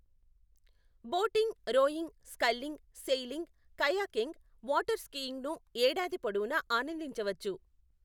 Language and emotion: Telugu, neutral